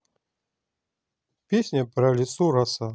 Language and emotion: Russian, neutral